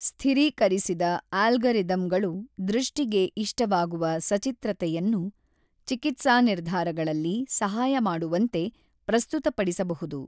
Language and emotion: Kannada, neutral